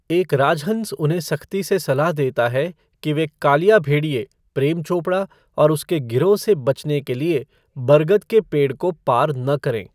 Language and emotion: Hindi, neutral